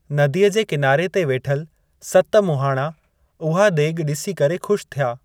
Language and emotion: Sindhi, neutral